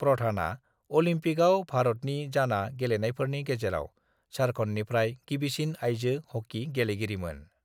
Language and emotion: Bodo, neutral